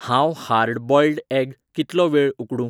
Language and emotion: Goan Konkani, neutral